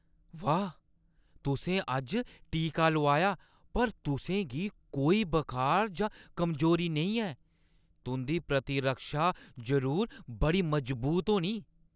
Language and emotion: Dogri, surprised